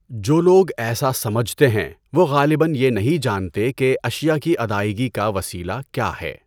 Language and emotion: Urdu, neutral